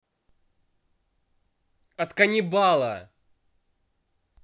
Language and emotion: Russian, angry